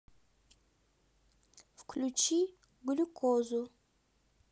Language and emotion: Russian, neutral